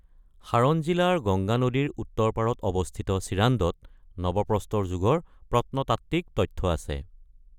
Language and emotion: Assamese, neutral